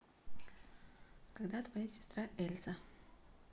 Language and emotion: Russian, neutral